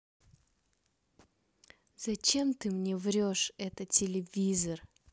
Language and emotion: Russian, neutral